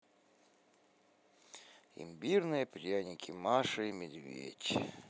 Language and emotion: Russian, positive